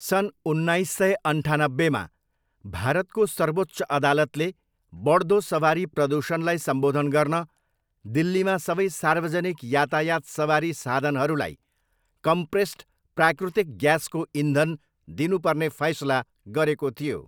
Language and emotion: Nepali, neutral